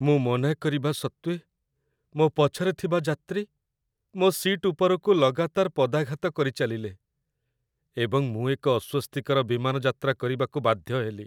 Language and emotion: Odia, sad